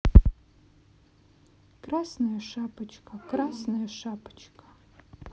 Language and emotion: Russian, sad